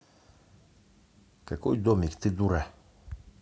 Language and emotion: Russian, angry